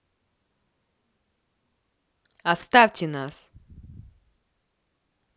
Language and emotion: Russian, angry